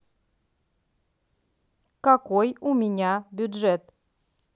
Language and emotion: Russian, neutral